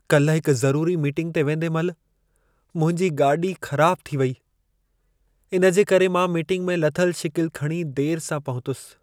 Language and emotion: Sindhi, sad